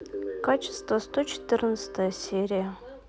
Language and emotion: Russian, neutral